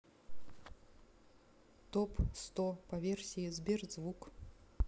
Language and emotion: Russian, neutral